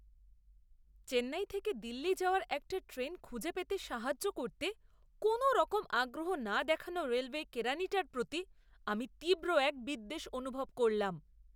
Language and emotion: Bengali, disgusted